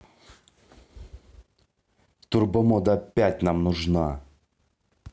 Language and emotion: Russian, angry